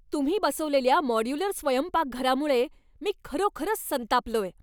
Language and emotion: Marathi, angry